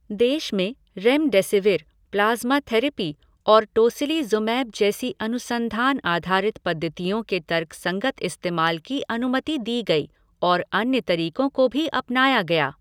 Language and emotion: Hindi, neutral